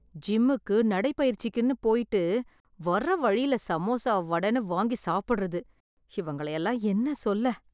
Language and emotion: Tamil, disgusted